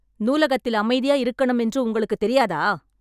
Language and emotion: Tamil, angry